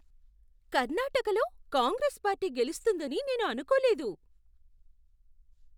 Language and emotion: Telugu, surprised